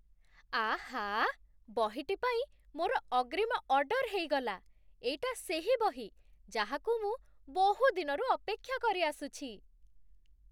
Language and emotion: Odia, surprised